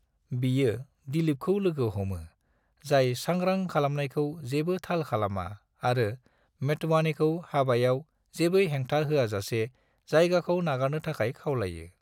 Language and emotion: Bodo, neutral